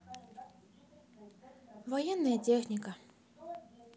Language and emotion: Russian, sad